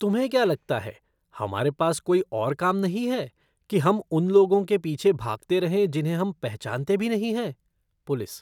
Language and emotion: Hindi, disgusted